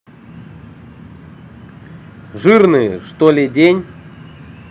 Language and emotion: Russian, neutral